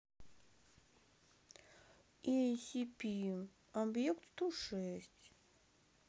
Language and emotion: Russian, neutral